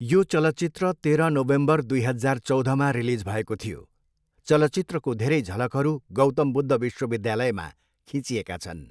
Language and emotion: Nepali, neutral